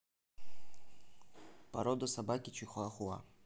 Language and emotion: Russian, neutral